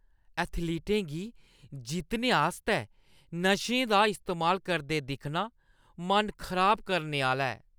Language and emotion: Dogri, disgusted